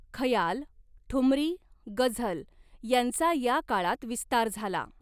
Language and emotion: Marathi, neutral